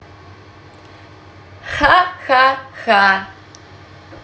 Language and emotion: Russian, positive